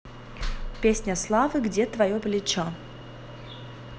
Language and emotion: Russian, neutral